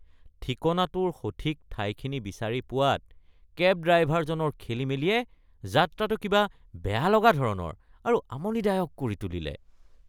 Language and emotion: Assamese, disgusted